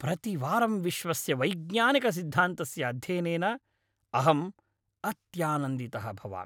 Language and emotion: Sanskrit, happy